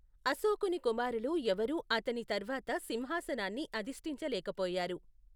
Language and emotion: Telugu, neutral